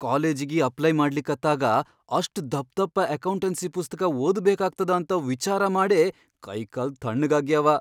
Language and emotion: Kannada, fearful